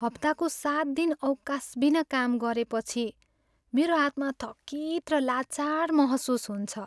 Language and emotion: Nepali, sad